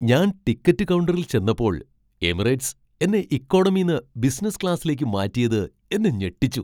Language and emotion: Malayalam, surprised